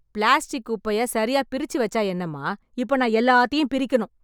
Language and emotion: Tamil, angry